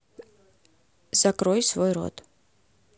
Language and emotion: Russian, neutral